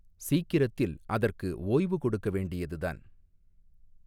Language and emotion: Tamil, neutral